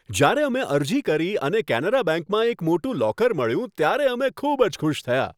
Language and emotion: Gujarati, happy